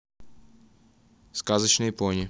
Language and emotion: Russian, neutral